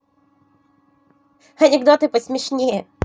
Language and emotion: Russian, positive